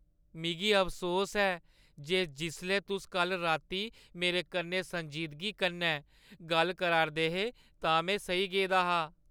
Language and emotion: Dogri, sad